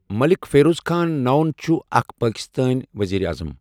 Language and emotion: Kashmiri, neutral